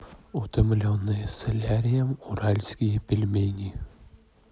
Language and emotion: Russian, neutral